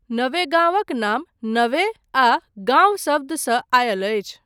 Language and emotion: Maithili, neutral